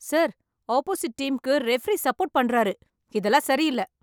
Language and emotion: Tamil, angry